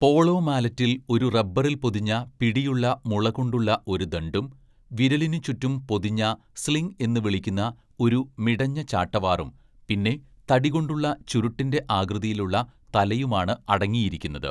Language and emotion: Malayalam, neutral